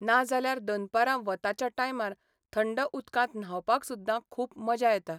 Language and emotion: Goan Konkani, neutral